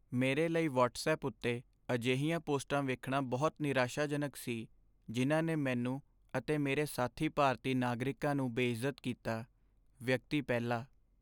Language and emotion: Punjabi, sad